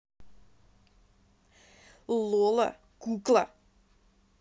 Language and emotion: Russian, neutral